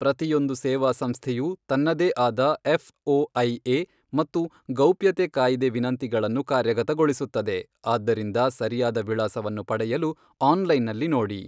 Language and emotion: Kannada, neutral